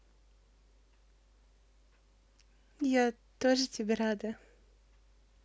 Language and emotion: Russian, positive